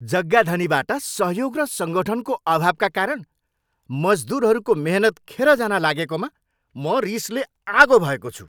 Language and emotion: Nepali, angry